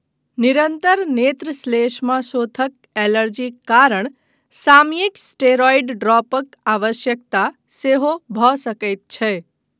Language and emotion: Maithili, neutral